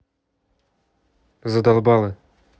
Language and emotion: Russian, angry